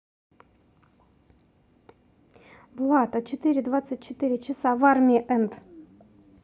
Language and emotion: Russian, neutral